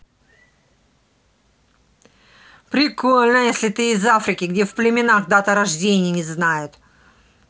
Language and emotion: Russian, angry